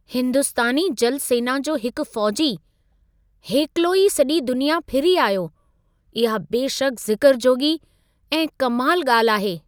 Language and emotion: Sindhi, surprised